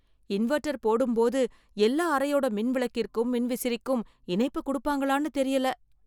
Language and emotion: Tamil, fearful